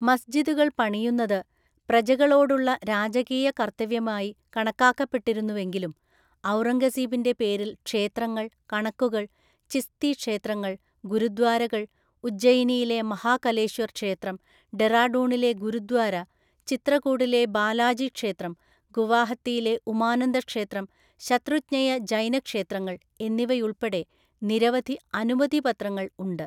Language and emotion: Malayalam, neutral